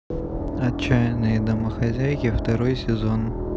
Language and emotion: Russian, neutral